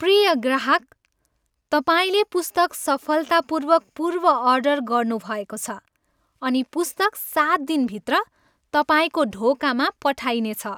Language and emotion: Nepali, happy